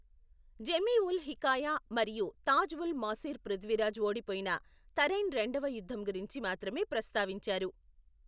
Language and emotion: Telugu, neutral